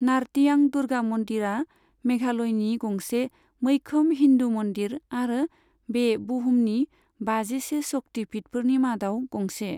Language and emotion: Bodo, neutral